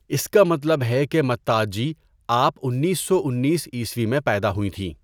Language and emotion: Urdu, neutral